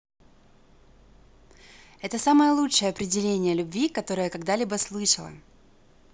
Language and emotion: Russian, positive